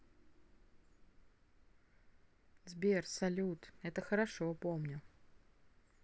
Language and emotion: Russian, neutral